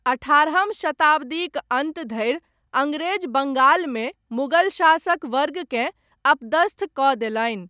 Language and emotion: Maithili, neutral